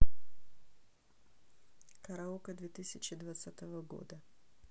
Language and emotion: Russian, neutral